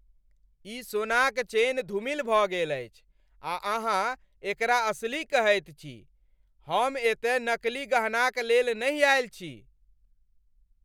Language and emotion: Maithili, angry